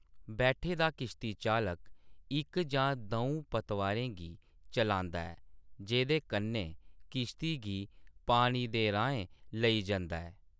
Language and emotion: Dogri, neutral